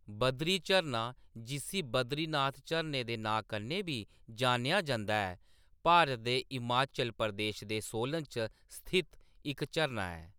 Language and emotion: Dogri, neutral